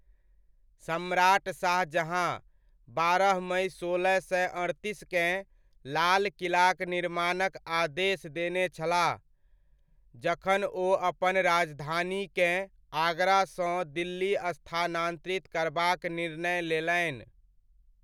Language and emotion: Maithili, neutral